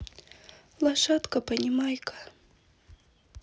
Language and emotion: Russian, sad